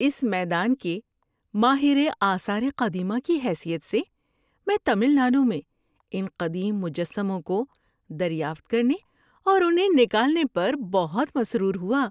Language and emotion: Urdu, happy